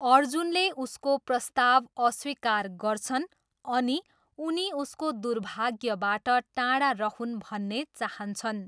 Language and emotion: Nepali, neutral